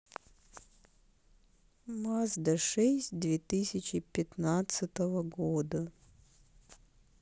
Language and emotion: Russian, sad